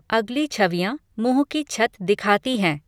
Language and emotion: Hindi, neutral